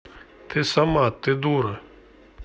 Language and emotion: Russian, neutral